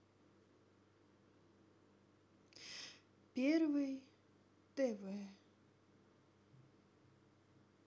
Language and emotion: Russian, sad